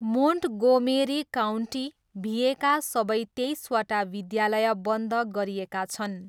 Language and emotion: Nepali, neutral